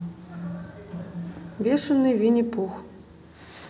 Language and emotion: Russian, neutral